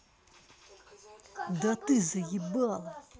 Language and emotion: Russian, angry